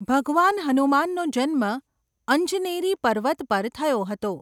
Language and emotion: Gujarati, neutral